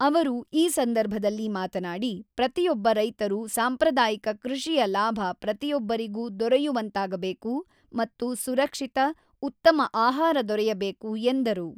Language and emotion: Kannada, neutral